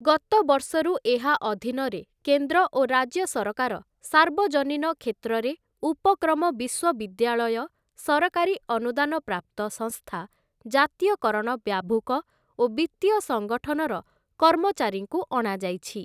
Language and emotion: Odia, neutral